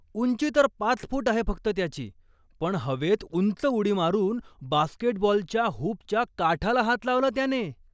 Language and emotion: Marathi, surprised